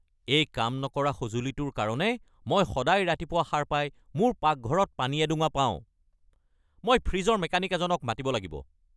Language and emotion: Assamese, angry